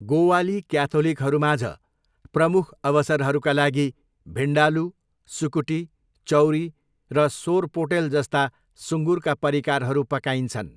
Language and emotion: Nepali, neutral